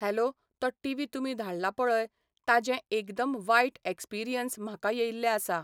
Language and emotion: Goan Konkani, neutral